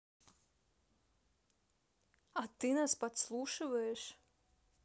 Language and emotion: Russian, neutral